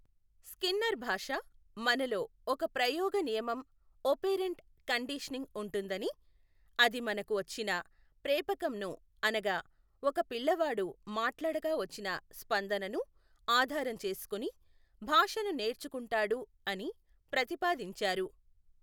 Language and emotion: Telugu, neutral